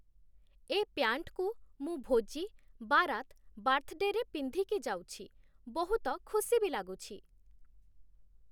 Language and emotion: Odia, neutral